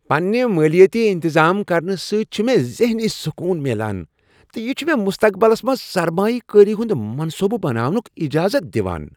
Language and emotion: Kashmiri, happy